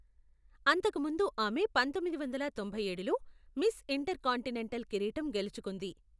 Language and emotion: Telugu, neutral